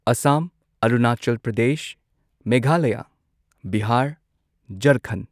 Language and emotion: Manipuri, neutral